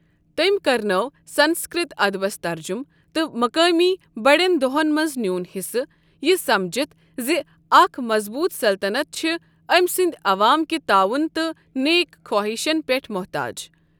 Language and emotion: Kashmiri, neutral